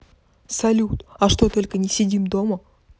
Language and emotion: Russian, neutral